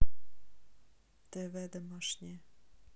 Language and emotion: Russian, neutral